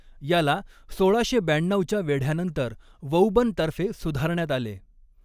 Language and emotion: Marathi, neutral